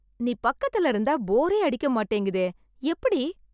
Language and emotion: Tamil, surprised